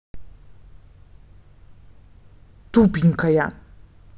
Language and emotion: Russian, angry